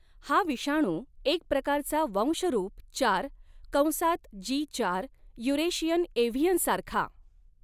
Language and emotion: Marathi, neutral